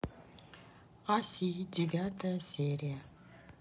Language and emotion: Russian, neutral